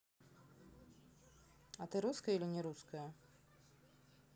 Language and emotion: Russian, neutral